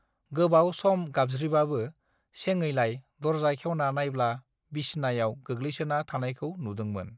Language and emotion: Bodo, neutral